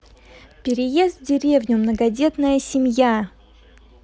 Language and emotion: Russian, positive